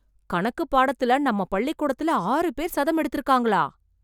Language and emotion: Tamil, surprised